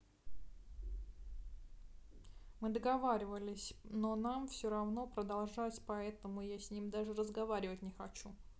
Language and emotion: Russian, neutral